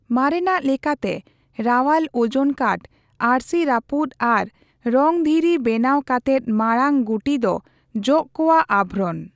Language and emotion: Santali, neutral